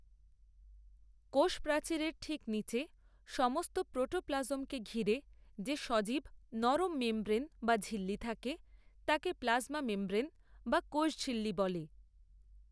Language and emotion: Bengali, neutral